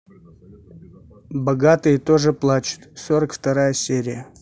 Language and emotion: Russian, neutral